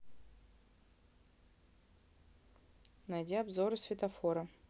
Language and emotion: Russian, neutral